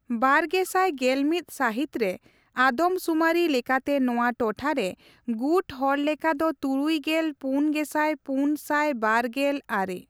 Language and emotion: Santali, neutral